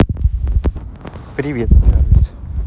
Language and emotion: Russian, positive